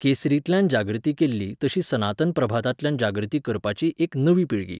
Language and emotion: Goan Konkani, neutral